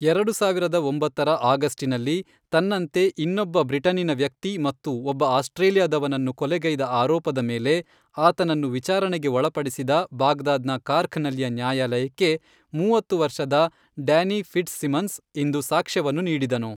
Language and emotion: Kannada, neutral